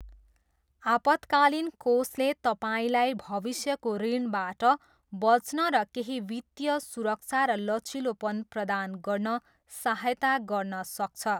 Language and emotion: Nepali, neutral